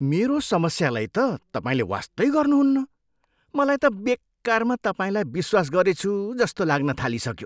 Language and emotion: Nepali, disgusted